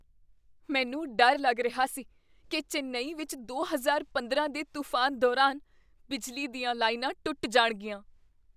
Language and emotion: Punjabi, fearful